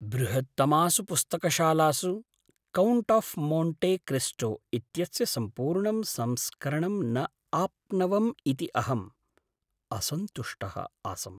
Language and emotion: Sanskrit, sad